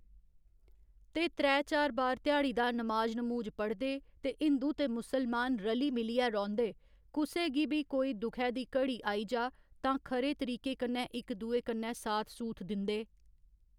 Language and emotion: Dogri, neutral